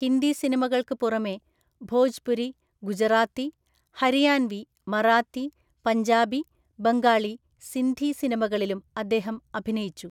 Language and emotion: Malayalam, neutral